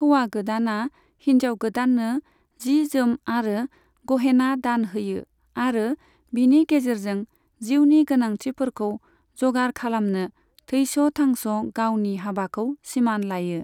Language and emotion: Bodo, neutral